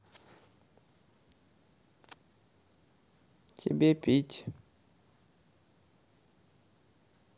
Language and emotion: Russian, neutral